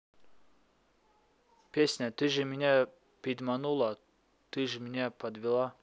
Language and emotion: Russian, neutral